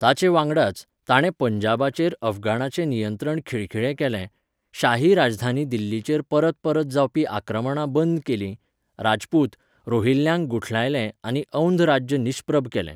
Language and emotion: Goan Konkani, neutral